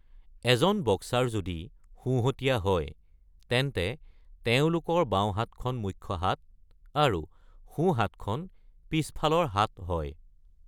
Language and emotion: Assamese, neutral